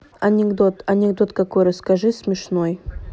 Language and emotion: Russian, neutral